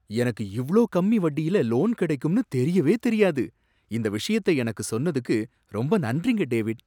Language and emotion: Tamil, surprised